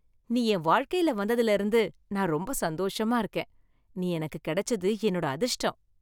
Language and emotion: Tamil, happy